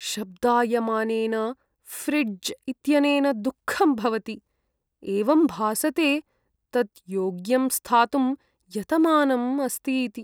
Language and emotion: Sanskrit, sad